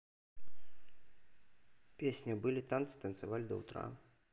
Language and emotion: Russian, neutral